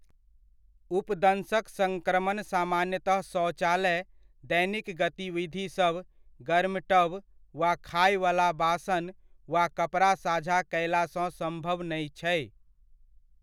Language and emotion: Maithili, neutral